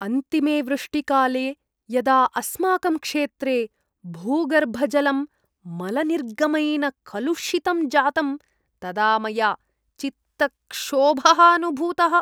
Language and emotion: Sanskrit, disgusted